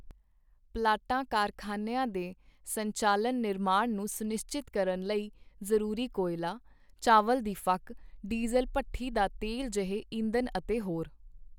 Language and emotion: Punjabi, neutral